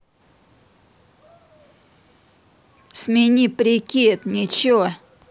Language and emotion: Russian, angry